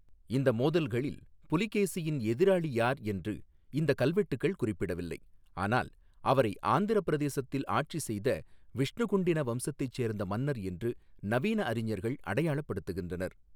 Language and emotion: Tamil, neutral